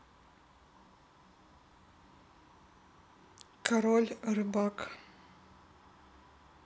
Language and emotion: Russian, neutral